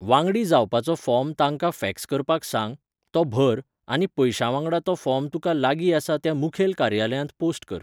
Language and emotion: Goan Konkani, neutral